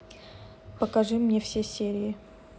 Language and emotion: Russian, neutral